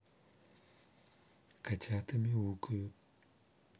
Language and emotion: Russian, neutral